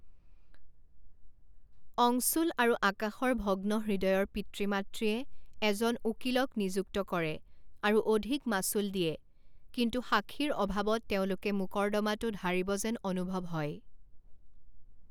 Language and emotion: Assamese, neutral